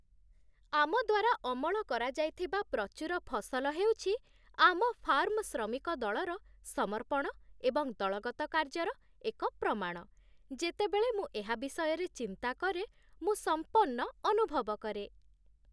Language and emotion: Odia, happy